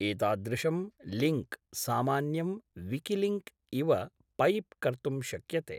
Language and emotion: Sanskrit, neutral